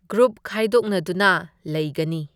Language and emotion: Manipuri, neutral